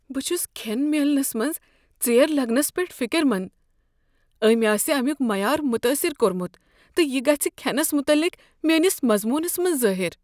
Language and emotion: Kashmiri, fearful